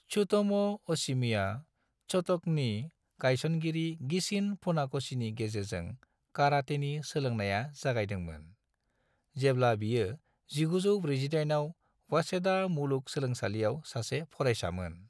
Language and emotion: Bodo, neutral